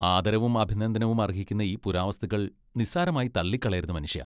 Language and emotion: Malayalam, disgusted